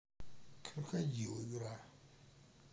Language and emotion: Russian, neutral